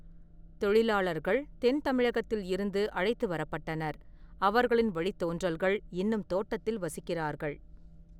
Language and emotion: Tamil, neutral